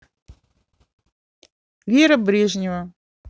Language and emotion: Russian, neutral